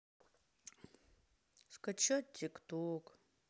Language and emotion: Russian, sad